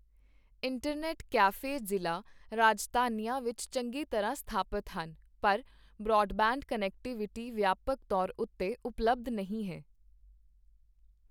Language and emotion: Punjabi, neutral